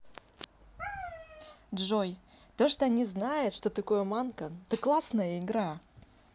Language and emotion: Russian, positive